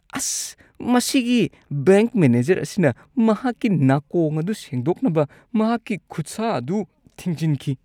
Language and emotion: Manipuri, disgusted